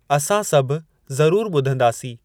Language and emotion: Sindhi, neutral